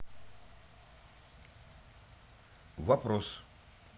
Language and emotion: Russian, neutral